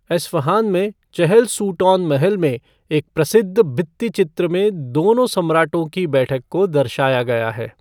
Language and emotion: Hindi, neutral